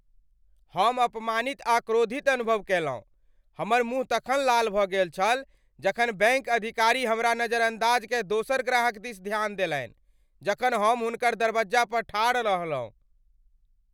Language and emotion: Maithili, angry